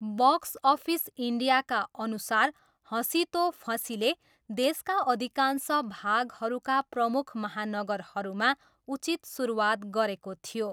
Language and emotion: Nepali, neutral